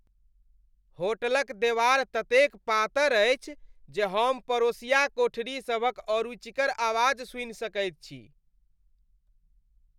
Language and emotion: Maithili, disgusted